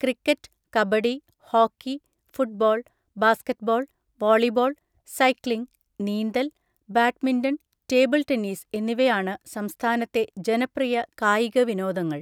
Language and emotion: Malayalam, neutral